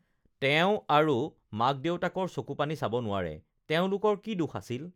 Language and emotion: Assamese, neutral